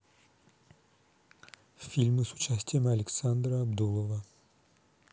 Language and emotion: Russian, neutral